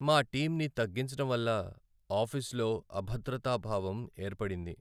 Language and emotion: Telugu, sad